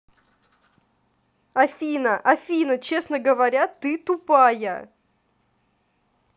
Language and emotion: Russian, angry